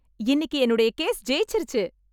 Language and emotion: Tamil, happy